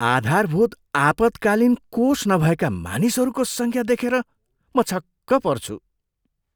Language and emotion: Nepali, surprised